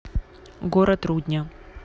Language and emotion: Russian, neutral